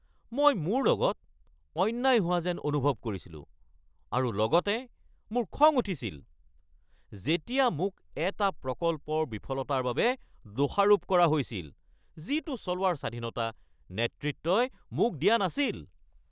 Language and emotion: Assamese, angry